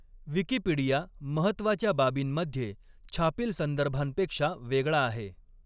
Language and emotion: Marathi, neutral